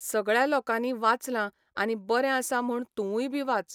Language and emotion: Goan Konkani, neutral